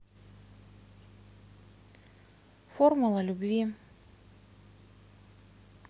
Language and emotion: Russian, neutral